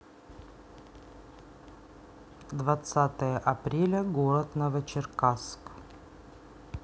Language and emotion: Russian, neutral